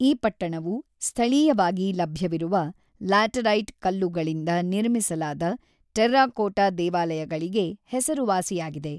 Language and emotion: Kannada, neutral